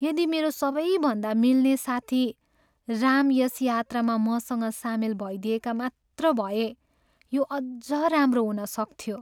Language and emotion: Nepali, sad